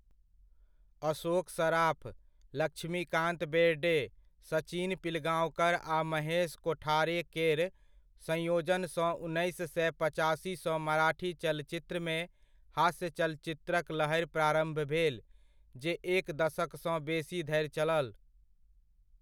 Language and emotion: Maithili, neutral